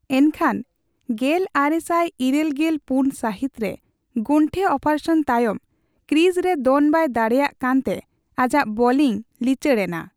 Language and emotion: Santali, neutral